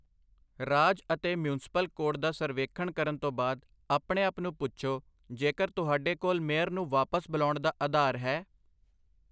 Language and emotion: Punjabi, neutral